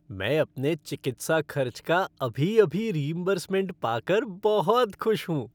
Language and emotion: Hindi, happy